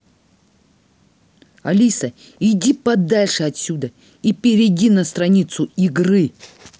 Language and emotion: Russian, angry